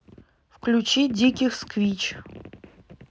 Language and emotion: Russian, neutral